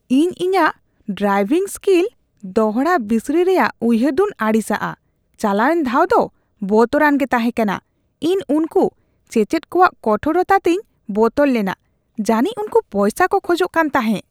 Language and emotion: Santali, disgusted